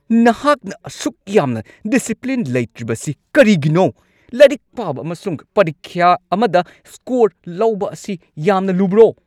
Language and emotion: Manipuri, angry